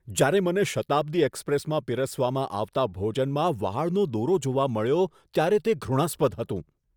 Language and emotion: Gujarati, disgusted